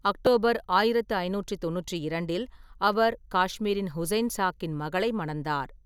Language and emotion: Tamil, neutral